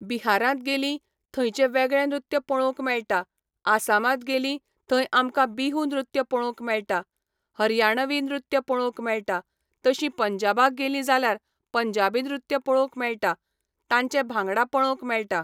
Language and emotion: Goan Konkani, neutral